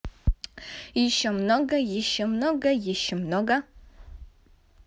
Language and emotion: Russian, positive